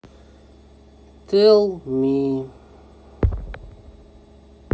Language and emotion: Russian, neutral